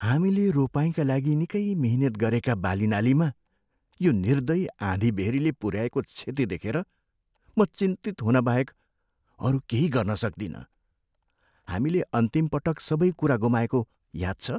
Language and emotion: Nepali, fearful